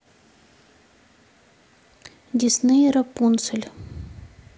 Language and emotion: Russian, neutral